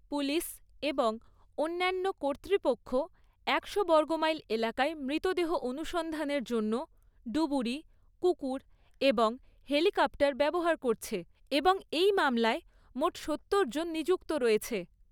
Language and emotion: Bengali, neutral